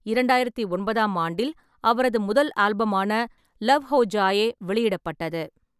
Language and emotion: Tamil, neutral